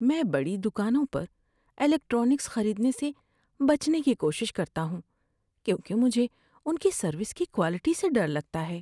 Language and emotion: Urdu, fearful